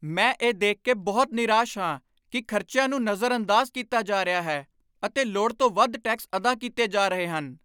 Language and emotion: Punjabi, angry